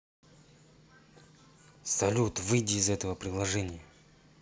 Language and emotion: Russian, angry